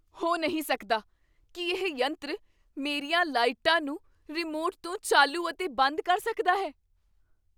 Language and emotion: Punjabi, surprised